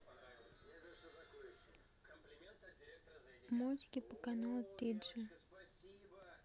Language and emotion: Russian, neutral